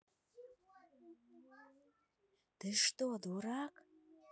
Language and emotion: Russian, angry